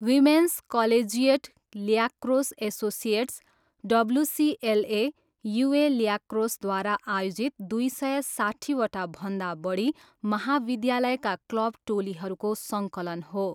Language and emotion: Nepali, neutral